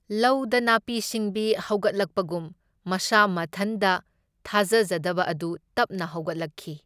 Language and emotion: Manipuri, neutral